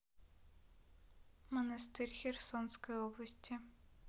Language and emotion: Russian, neutral